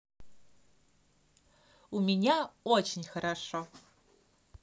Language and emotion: Russian, positive